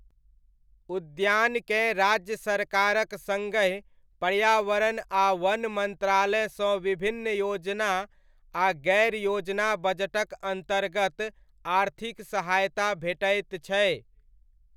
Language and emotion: Maithili, neutral